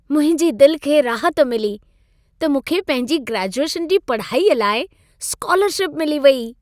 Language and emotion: Sindhi, happy